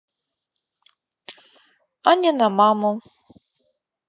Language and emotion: Russian, neutral